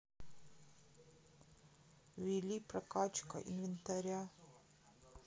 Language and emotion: Russian, sad